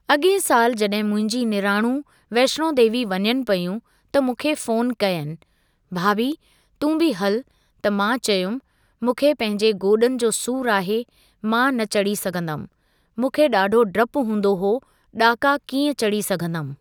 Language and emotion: Sindhi, neutral